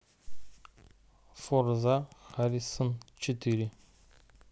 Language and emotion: Russian, neutral